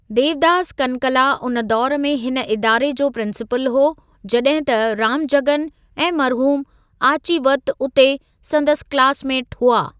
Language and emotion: Sindhi, neutral